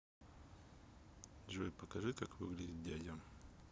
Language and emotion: Russian, neutral